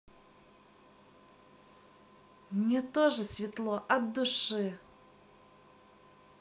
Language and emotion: Russian, positive